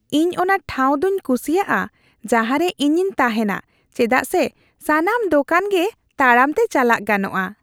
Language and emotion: Santali, happy